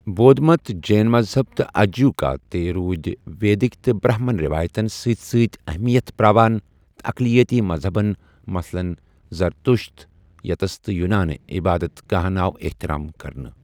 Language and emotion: Kashmiri, neutral